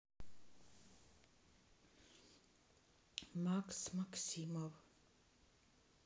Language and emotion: Russian, neutral